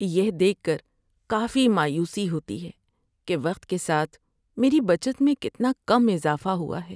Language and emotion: Urdu, sad